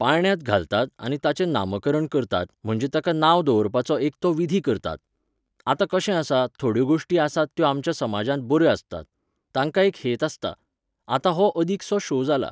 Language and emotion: Goan Konkani, neutral